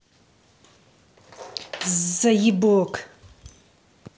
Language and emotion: Russian, angry